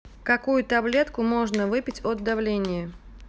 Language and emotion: Russian, neutral